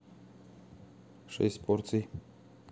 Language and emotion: Russian, neutral